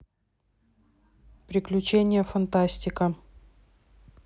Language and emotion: Russian, neutral